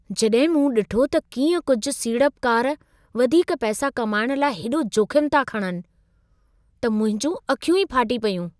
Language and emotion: Sindhi, surprised